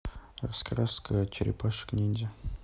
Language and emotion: Russian, neutral